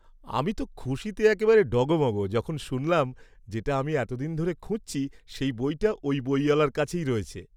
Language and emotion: Bengali, happy